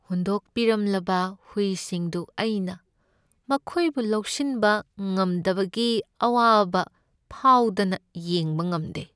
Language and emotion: Manipuri, sad